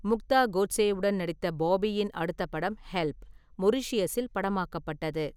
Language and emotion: Tamil, neutral